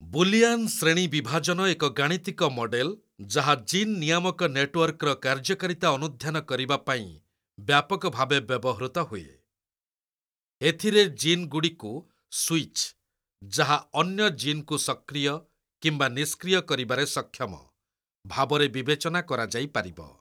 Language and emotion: Odia, neutral